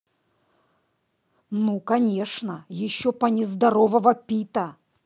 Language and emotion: Russian, angry